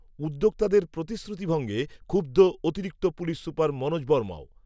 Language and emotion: Bengali, neutral